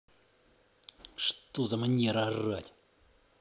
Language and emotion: Russian, angry